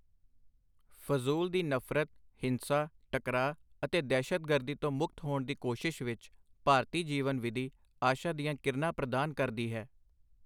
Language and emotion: Punjabi, neutral